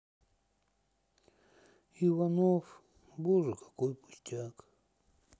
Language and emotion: Russian, sad